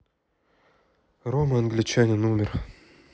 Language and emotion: Russian, sad